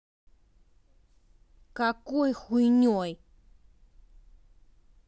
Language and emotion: Russian, angry